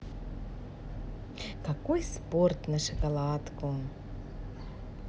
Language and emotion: Russian, positive